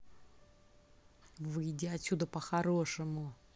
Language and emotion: Russian, angry